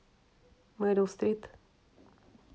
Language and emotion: Russian, neutral